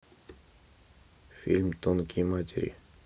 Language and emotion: Russian, neutral